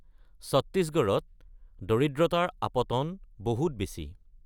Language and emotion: Assamese, neutral